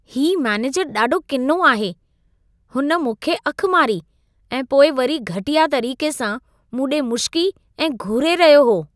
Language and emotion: Sindhi, disgusted